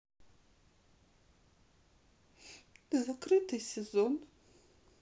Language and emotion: Russian, sad